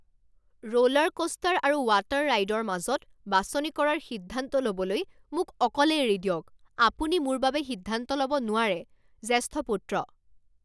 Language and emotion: Assamese, angry